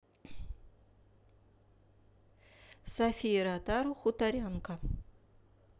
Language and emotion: Russian, neutral